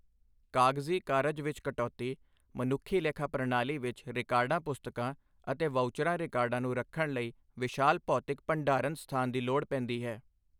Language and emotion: Punjabi, neutral